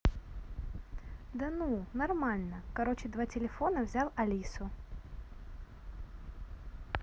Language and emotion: Russian, positive